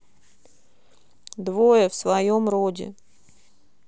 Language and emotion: Russian, neutral